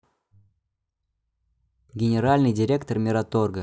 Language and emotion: Russian, neutral